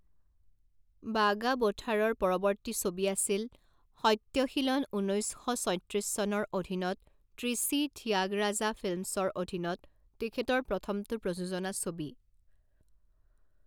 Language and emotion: Assamese, neutral